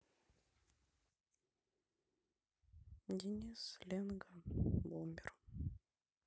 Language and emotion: Russian, sad